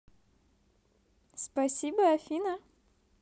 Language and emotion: Russian, positive